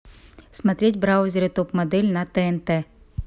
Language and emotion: Russian, neutral